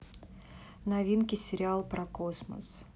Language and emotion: Russian, neutral